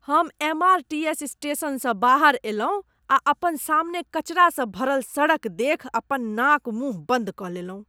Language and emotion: Maithili, disgusted